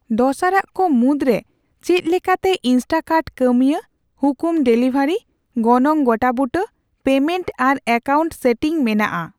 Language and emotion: Santali, neutral